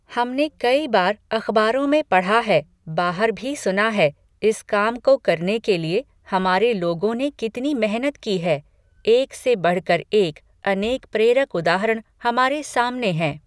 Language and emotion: Hindi, neutral